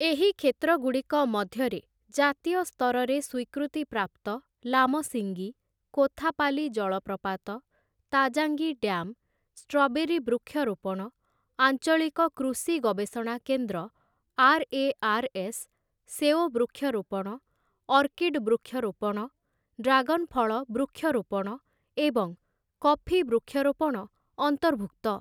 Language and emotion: Odia, neutral